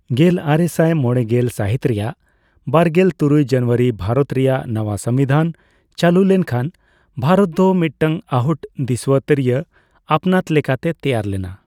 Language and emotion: Santali, neutral